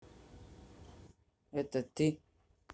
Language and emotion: Russian, neutral